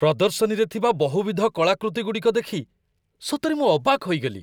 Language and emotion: Odia, surprised